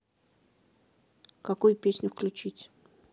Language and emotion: Russian, neutral